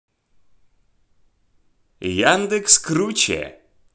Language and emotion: Russian, positive